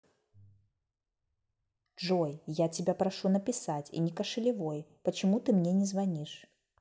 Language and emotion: Russian, angry